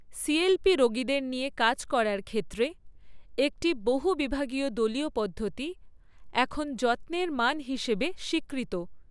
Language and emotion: Bengali, neutral